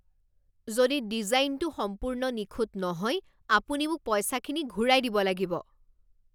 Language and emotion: Assamese, angry